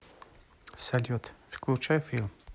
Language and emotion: Russian, neutral